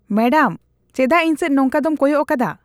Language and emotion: Santali, disgusted